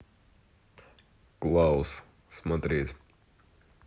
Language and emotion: Russian, neutral